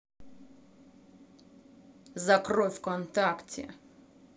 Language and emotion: Russian, angry